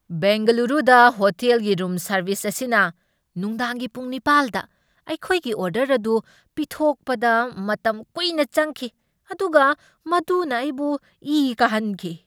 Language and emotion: Manipuri, angry